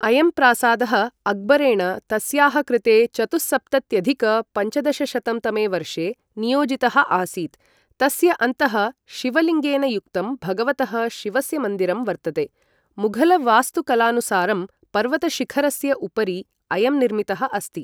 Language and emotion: Sanskrit, neutral